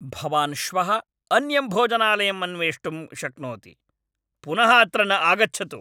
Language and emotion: Sanskrit, angry